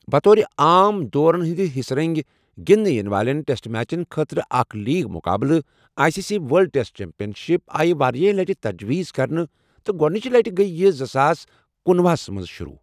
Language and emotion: Kashmiri, neutral